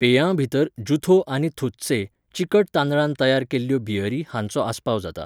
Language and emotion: Goan Konkani, neutral